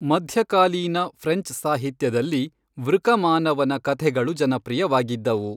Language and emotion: Kannada, neutral